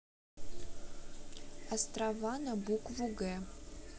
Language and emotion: Russian, neutral